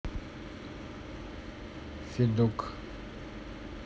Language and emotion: Russian, neutral